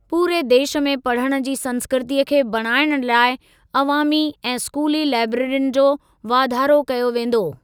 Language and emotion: Sindhi, neutral